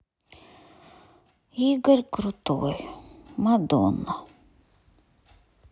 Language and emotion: Russian, sad